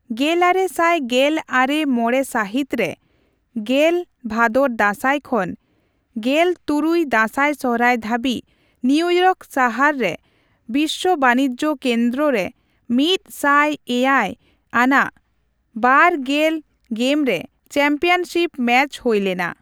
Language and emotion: Santali, neutral